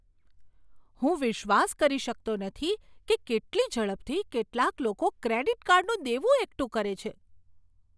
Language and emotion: Gujarati, surprised